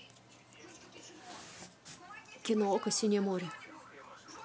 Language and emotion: Russian, neutral